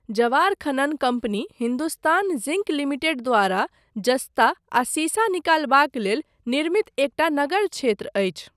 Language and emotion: Maithili, neutral